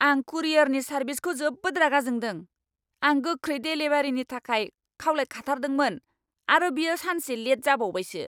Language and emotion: Bodo, angry